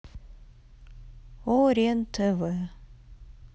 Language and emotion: Russian, neutral